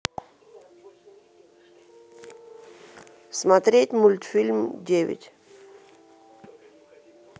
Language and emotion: Russian, neutral